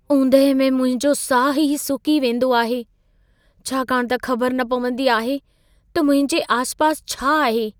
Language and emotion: Sindhi, fearful